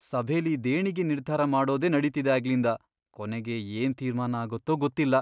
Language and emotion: Kannada, fearful